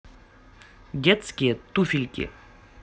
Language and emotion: Russian, positive